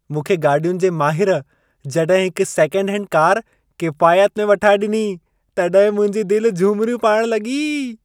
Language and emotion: Sindhi, happy